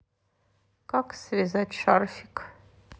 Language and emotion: Russian, neutral